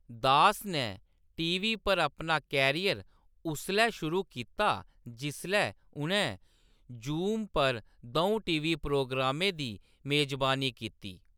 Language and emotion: Dogri, neutral